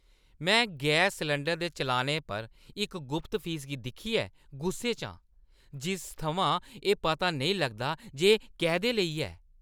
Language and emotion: Dogri, angry